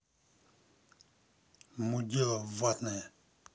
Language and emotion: Russian, angry